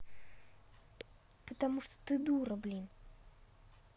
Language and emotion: Russian, angry